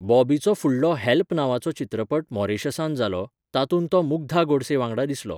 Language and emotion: Goan Konkani, neutral